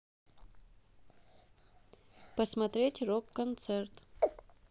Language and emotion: Russian, neutral